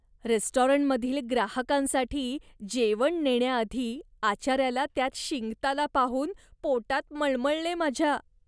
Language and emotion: Marathi, disgusted